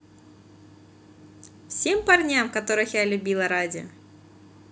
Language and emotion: Russian, positive